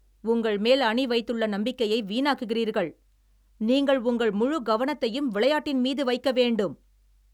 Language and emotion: Tamil, angry